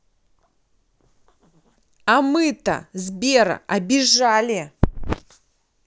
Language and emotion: Russian, angry